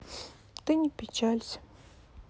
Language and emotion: Russian, sad